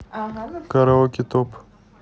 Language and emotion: Russian, neutral